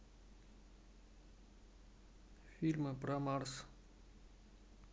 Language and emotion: Russian, neutral